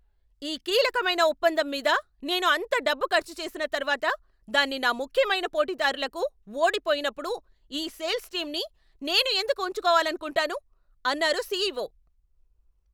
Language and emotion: Telugu, angry